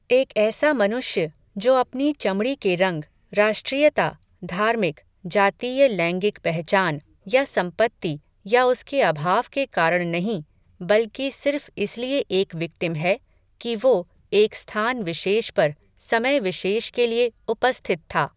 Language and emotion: Hindi, neutral